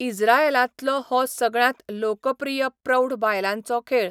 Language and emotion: Goan Konkani, neutral